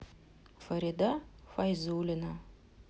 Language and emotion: Russian, sad